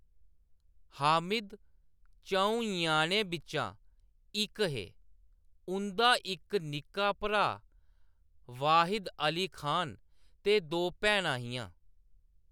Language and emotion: Dogri, neutral